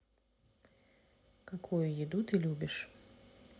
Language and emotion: Russian, neutral